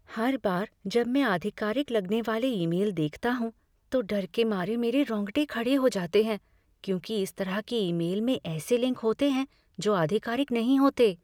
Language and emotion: Hindi, fearful